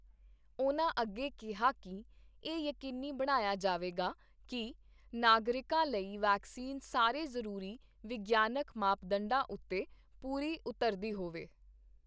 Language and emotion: Punjabi, neutral